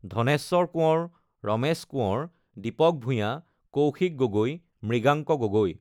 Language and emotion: Assamese, neutral